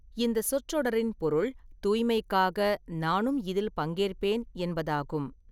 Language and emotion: Tamil, neutral